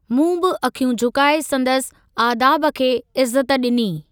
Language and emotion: Sindhi, neutral